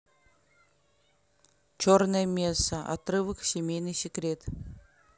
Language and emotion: Russian, neutral